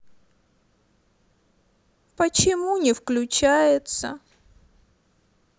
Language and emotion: Russian, sad